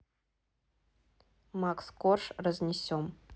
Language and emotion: Russian, neutral